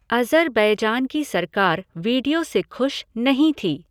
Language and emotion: Hindi, neutral